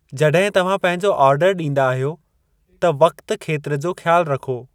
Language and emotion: Sindhi, neutral